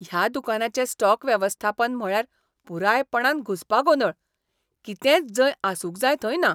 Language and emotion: Goan Konkani, disgusted